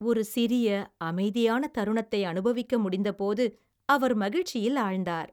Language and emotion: Tamil, happy